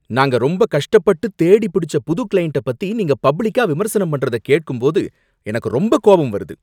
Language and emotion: Tamil, angry